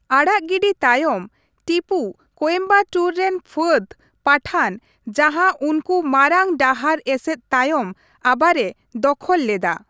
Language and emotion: Santali, neutral